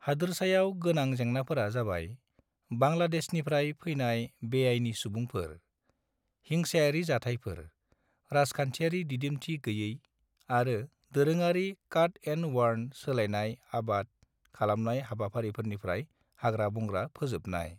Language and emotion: Bodo, neutral